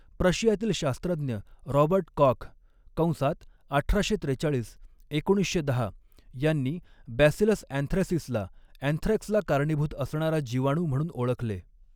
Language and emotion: Marathi, neutral